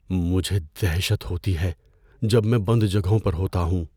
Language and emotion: Urdu, fearful